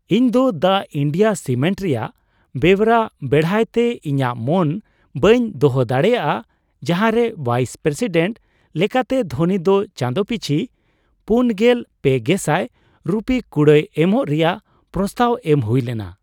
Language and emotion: Santali, surprised